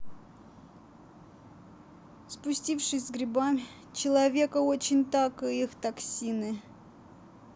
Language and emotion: Russian, sad